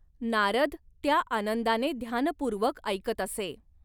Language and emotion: Marathi, neutral